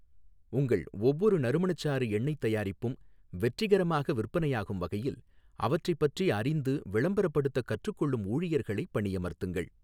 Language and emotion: Tamil, neutral